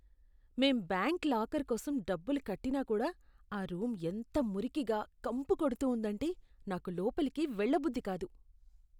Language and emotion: Telugu, disgusted